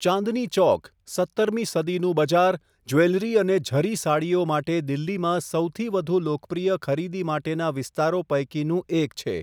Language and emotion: Gujarati, neutral